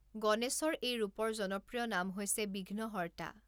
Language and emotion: Assamese, neutral